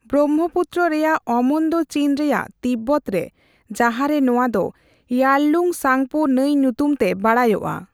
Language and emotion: Santali, neutral